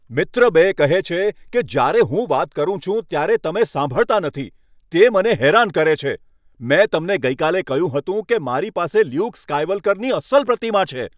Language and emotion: Gujarati, angry